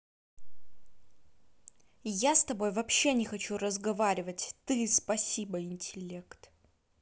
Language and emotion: Russian, angry